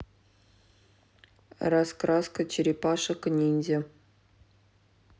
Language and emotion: Russian, neutral